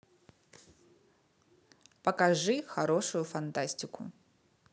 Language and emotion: Russian, neutral